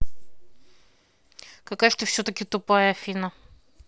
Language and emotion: Russian, angry